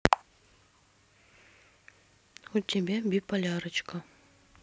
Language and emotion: Russian, neutral